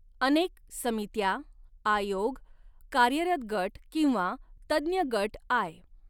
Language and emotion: Marathi, neutral